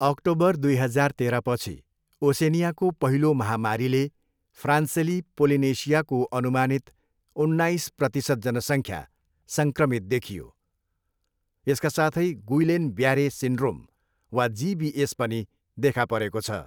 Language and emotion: Nepali, neutral